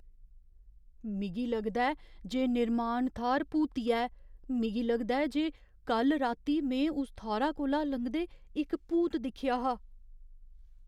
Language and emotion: Dogri, fearful